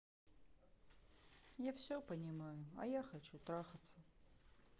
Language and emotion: Russian, sad